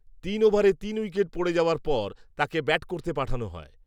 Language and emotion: Bengali, neutral